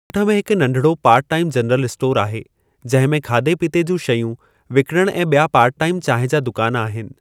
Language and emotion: Sindhi, neutral